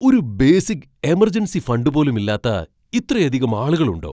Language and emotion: Malayalam, surprised